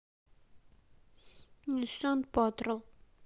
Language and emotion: Russian, sad